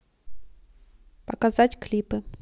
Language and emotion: Russian, neutral